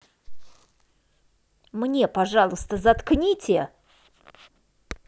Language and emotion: Russian, angry